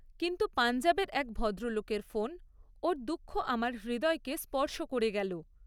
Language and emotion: Bengali, neutral